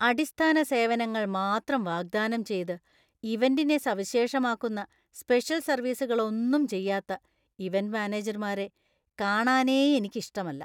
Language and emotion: Malayalam, disgusted